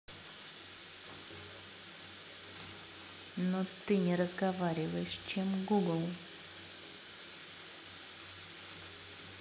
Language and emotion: Russian, neutral